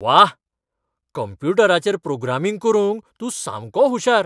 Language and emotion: Goan Konkani, surprised